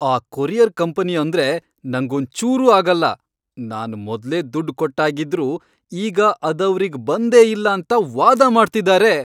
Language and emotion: Kannada, angry